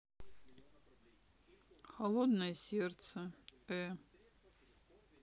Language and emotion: Russian, sad